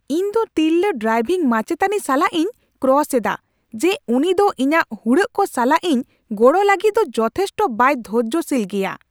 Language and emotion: Santali, angry